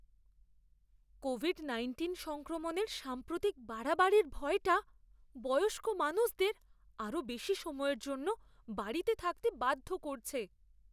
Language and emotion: Bengali, fearful